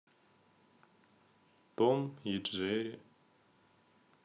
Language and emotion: Russian, sad